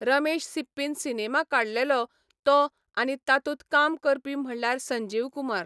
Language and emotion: Goan Konkani, neutral